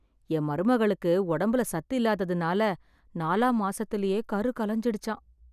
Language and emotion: Tamil, sad